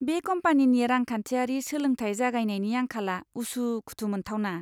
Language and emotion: Bodo, disgusted